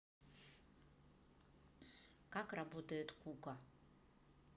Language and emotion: Russian, neutral